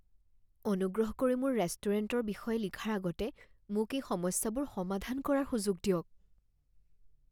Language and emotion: Assamese, fearful